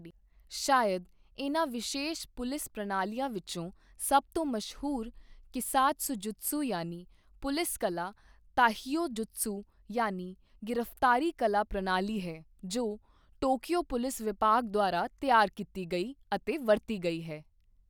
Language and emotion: Punjabi, neutral